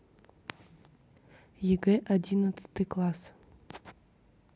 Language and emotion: Russian, neutral